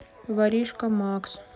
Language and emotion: Russian, sad